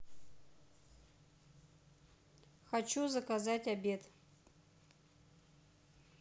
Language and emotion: Russian, neutral